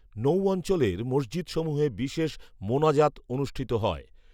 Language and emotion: Bengali, neutral